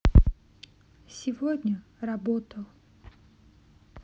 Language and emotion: Russian, sad